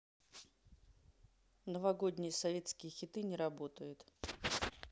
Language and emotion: Russian, neutral